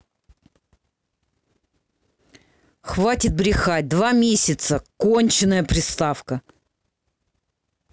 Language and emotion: Russian, angry